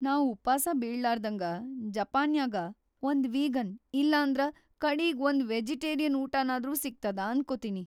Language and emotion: Kannada, fearful